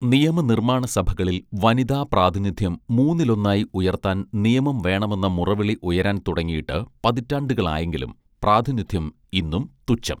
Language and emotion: Malayalam, neutral